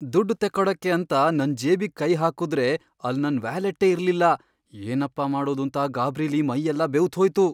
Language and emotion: Kannada, fearful